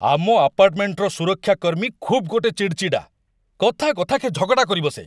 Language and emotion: Odia, angry